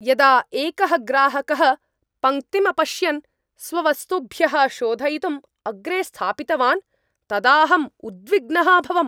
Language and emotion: Sanskrit, angry